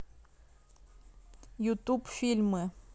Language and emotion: Russian, neutral